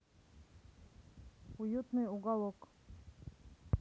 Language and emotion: Russian, neutral